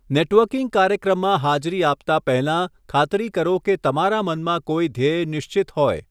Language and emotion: Gujarati, neutral